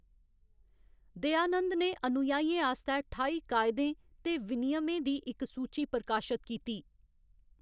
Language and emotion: Dogri, neutral